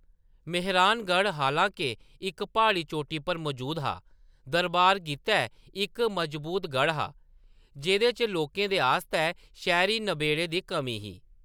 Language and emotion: Dogri, neutral